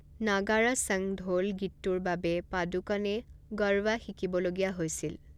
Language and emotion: Assamese, neutral